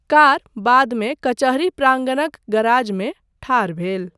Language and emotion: Maithili, neutral